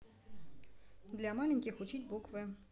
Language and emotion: Russian, neutral